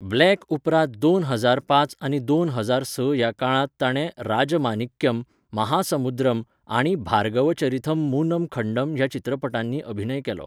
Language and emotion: Goan Konkani, neutral